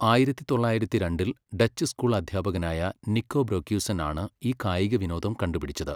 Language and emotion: Malayalam, neutral